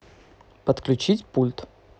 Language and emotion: Russian, neutral